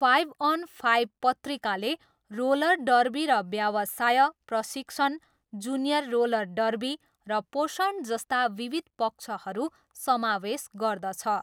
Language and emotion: Nepali, neutral